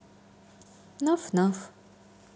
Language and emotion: Russian, neutral